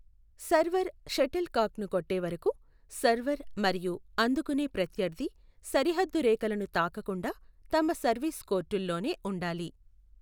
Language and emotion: Telugu, neutral